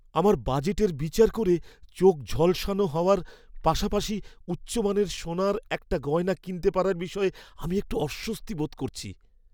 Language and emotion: Bengali, fearful